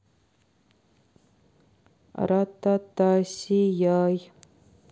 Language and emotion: Russian, neutral